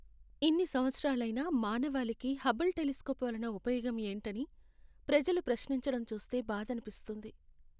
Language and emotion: Telugu, sad